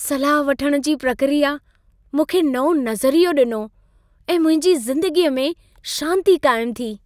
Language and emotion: Sindhi, happy